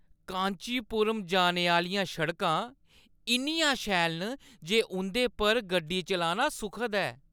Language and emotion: Dogri, happy